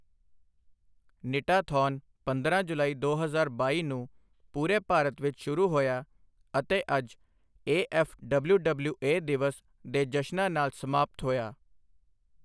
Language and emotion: Punjabi, neutral